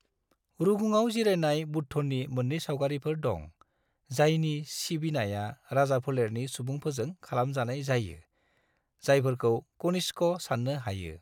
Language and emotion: Bodo, neutral